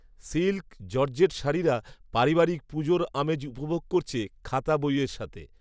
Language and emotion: Bengali, neutral